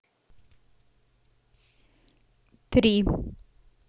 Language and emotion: Russian, neutral